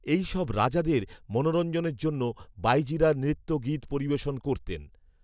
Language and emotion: Bengali, neutral